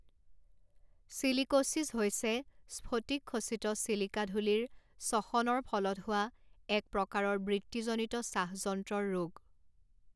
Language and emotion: Assamese, neutral